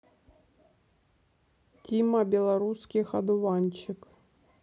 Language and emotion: Russian, neutral